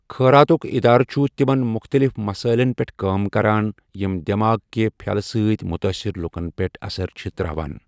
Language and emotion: Kashmiri, neutral